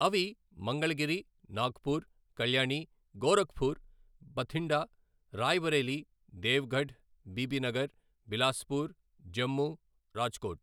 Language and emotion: Telugu, neutral